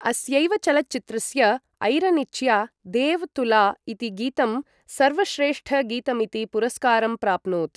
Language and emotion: Sanskrit, neutral